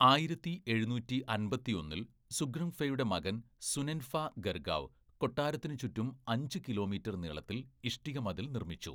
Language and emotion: Malayalam, neutral